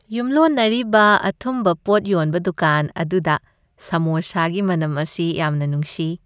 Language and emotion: Manipuri, happy